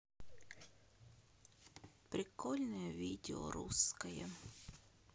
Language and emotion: Russian, sad